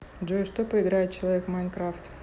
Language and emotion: Russian, neutral